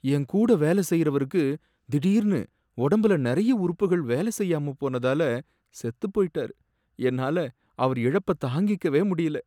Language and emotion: Tamil, sad